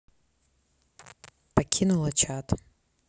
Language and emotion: Russian, neutral